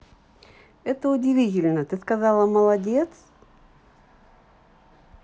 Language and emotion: Russian, positive